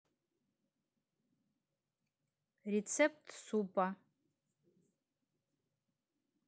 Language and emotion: Russian, neutral